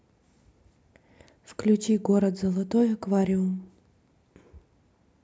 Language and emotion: Russian, neutral